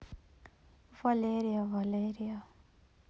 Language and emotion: Russian, sad